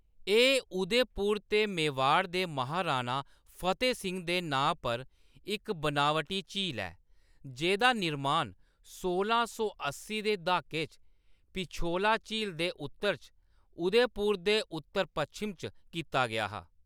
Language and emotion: Dogri, neutral